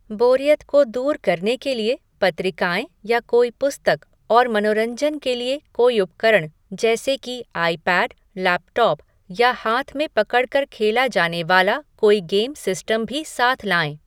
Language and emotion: Hindi, neutral